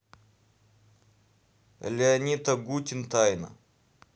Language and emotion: Russian, neutral